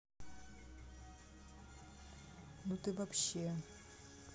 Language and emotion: Russian, neutral